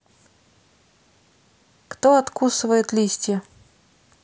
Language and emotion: Russian, neutral